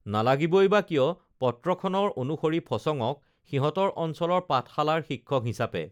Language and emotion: Assamese, neutral